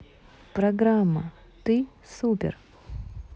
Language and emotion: Russian, neutral